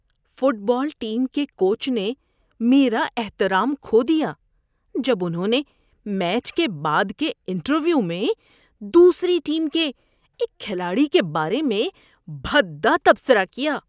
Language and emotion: Urdu, disgusted